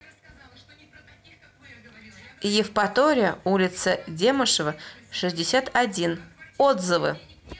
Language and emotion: Russian, neutral